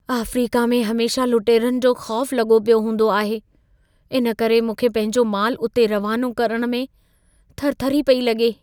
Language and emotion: Sindhi, fearful